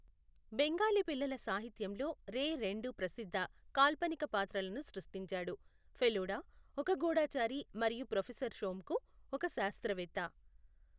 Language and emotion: Telugu, neutral